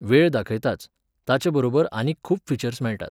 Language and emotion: Goan Konkani, neutral